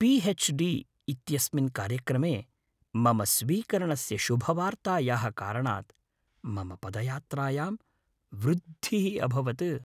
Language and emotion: Sanskrit, happy